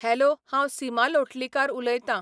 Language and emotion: Goan Konkani, neutral